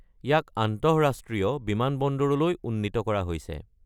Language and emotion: Assamese, neutral